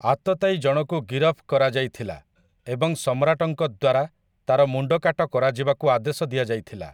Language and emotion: Odia, neutral